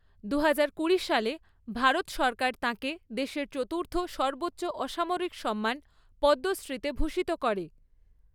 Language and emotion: Bengali, neutral